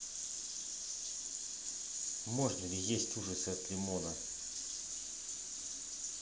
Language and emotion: Russian, neutral